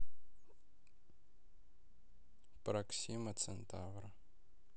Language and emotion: Russian, neutral